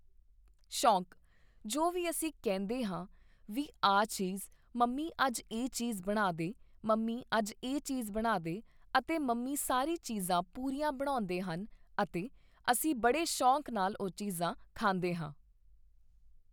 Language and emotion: Punjabi, neutral